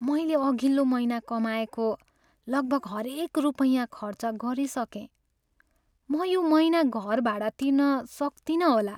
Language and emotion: Nepali, sad